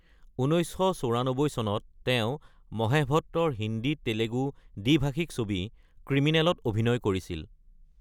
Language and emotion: Assamese, neutral